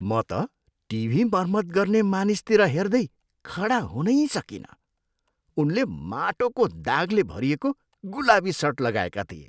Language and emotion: Nepali, disgusted